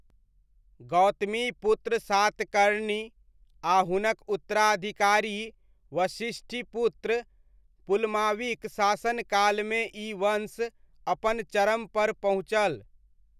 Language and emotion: Maithili, neutral